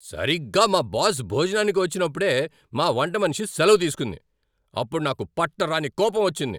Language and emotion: Telugu, angry